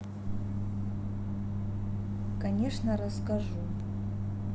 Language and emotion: Russian, neutral